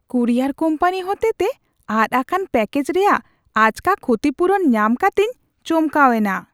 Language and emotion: Santali, surprised